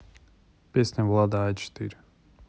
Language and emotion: Russian, neutral